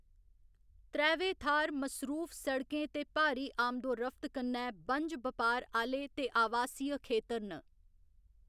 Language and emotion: Dogri, neutral